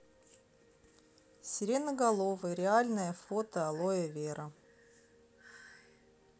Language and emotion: Russian, neutral